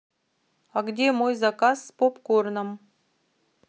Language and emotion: Russian, neutral